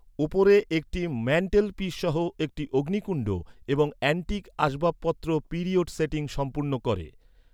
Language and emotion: Bengali, neutral